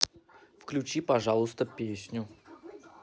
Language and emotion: Russian, neutral